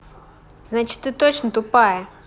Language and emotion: Russian, angry